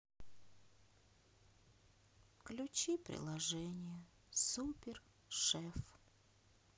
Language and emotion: Russian, sad